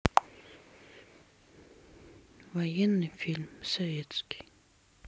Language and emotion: Russian, neutral